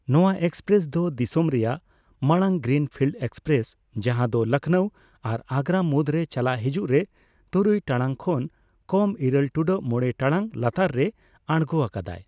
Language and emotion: Santali, neutral